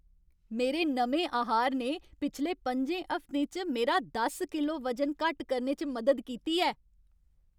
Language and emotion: Dogri, happy